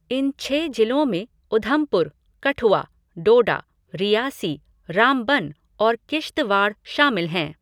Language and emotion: Hindi, neutral